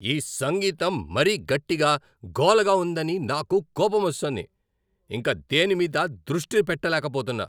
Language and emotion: Telugu, angry